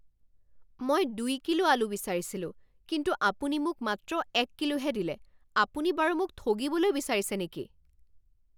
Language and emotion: Assamese, angry